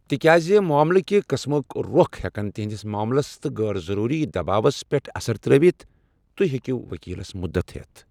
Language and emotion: Kashmiri, neutral